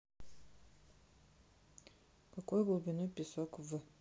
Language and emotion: Russian, neutral